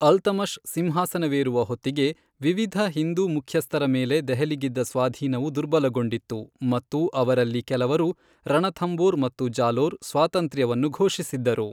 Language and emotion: Kannada, neutral